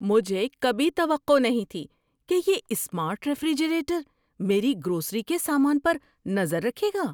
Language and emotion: Urdu, surprised